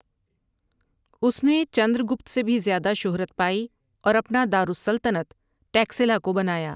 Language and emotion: Urdu, neutral